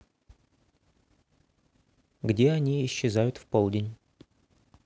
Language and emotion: Russian, neutral